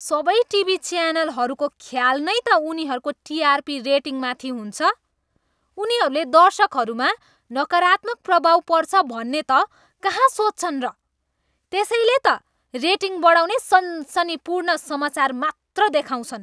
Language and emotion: Nepali, disgusted